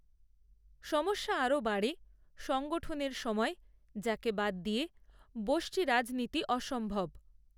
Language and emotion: Bengali, neutral